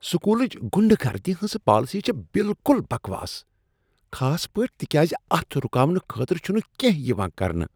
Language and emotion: Kashmiri, disgusted